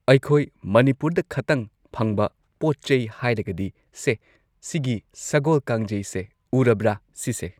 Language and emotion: Manipuri, neutral